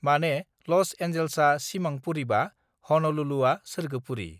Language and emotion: Bodo, neutral